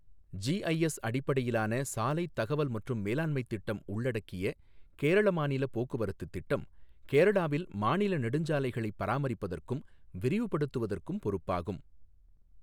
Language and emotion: Tamil, neutral